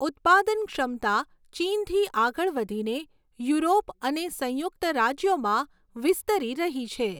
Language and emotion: Gujarati, neutral